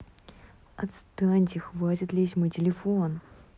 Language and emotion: Russian, angry